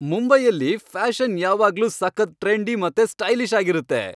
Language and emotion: Kannada, happy